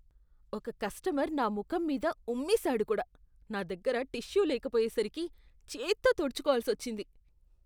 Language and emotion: Telugu, disgusted